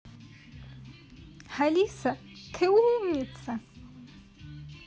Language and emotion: Russian, positive